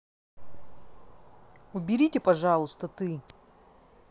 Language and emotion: Russian, angry